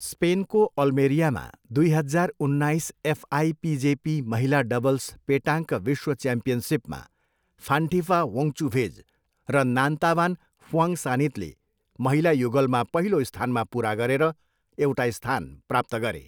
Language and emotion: Nepali, neutral